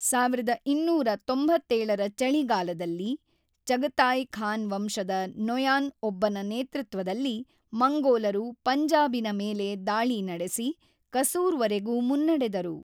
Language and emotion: Kannada, neutral